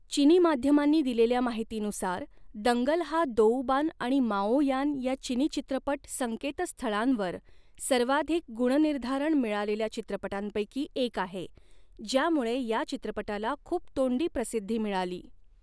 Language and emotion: Marathi, neutral